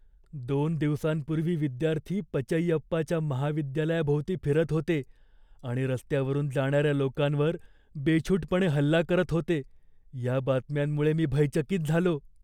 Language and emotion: Marathi, fearful